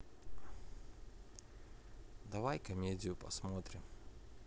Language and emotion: Russian, neutral